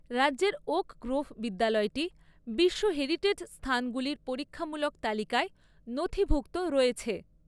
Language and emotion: Bengali, neutral